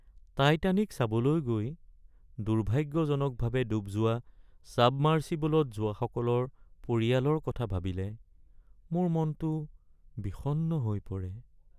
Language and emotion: Assamese, sad